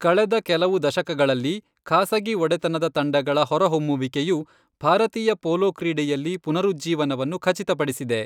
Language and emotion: Kannada, neutral